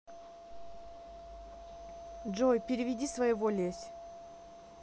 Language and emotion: Russian, neutral